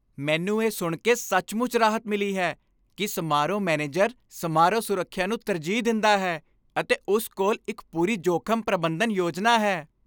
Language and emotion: Punjabi, happy